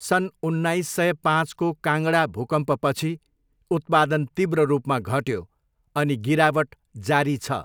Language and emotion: Nepali, neutral